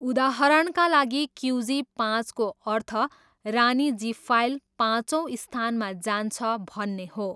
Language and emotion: Nepali, neutral